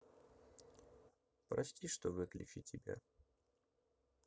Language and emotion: Russian, sad